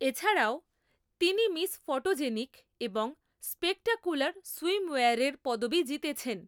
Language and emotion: Bengali, neutral